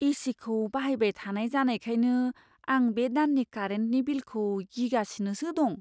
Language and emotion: Bodo, fearful